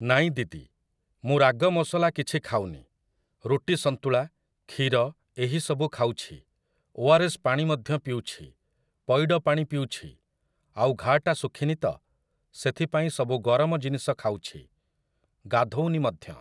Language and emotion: Odia, neutral